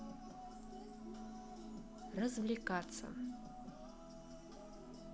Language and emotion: Russian, neutral